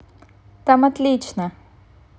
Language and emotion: Russian, positive